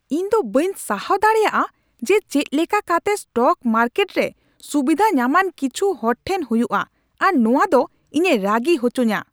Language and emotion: Santali, angry